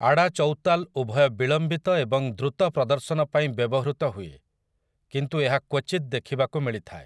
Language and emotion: Odia, neutral